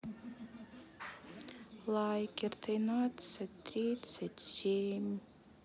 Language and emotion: Russian, sad